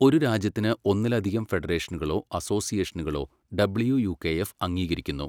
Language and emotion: Malayalam, neutral